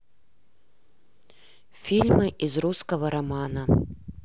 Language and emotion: Russian, neutral